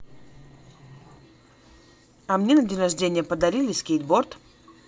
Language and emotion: Russian, positive